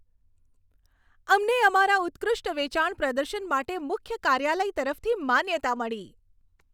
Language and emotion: Gujarati, happy